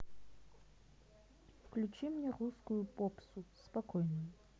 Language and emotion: Russian, neutral